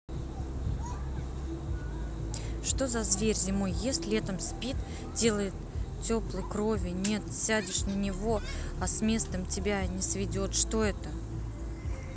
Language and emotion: Russian, neutral